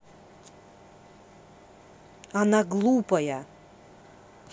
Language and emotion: Russian, angry